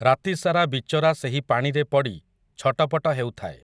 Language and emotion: Odia, neutral